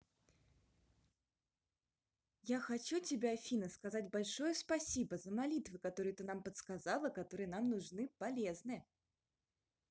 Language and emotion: Russian, positive